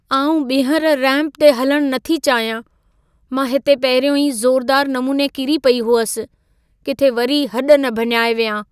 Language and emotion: Sindhi, fearful